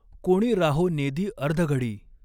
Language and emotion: Marathi, neutral